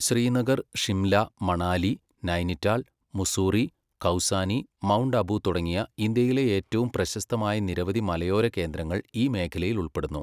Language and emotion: Malayalam, neutral